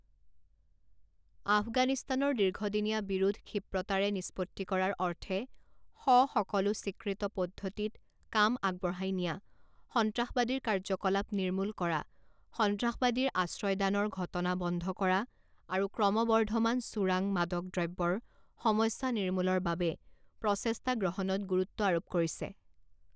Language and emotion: Assamese, neutral